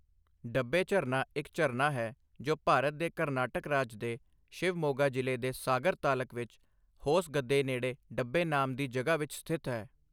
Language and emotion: Punjabi, neutral